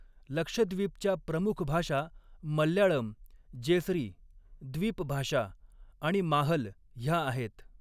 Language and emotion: Marathi, neutral